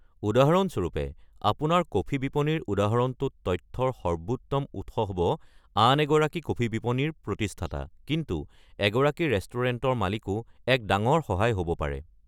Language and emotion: Assamese, neutral